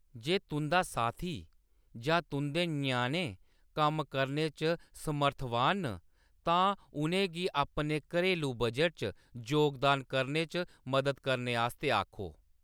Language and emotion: Dogri, neutral